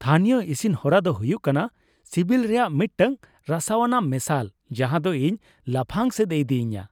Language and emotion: Santali, happy